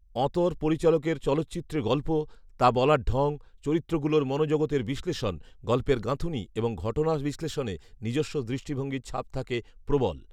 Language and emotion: Bengali, neutral